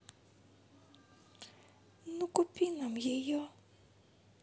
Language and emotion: Russian, sad